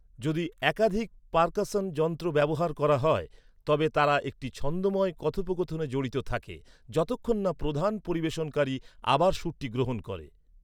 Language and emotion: Bengali, neutral